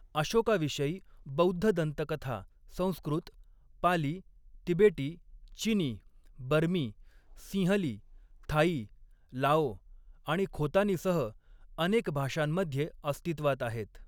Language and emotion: Marathi, neutral